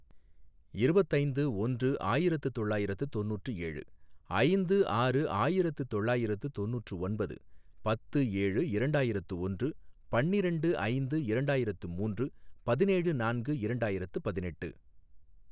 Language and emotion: Tamil, neutral